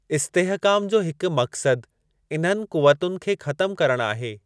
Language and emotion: Sindhi, neutral